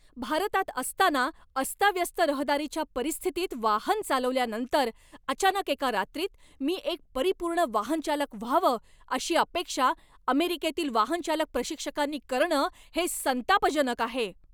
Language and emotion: Marathi, angry